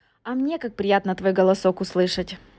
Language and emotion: Russian, positive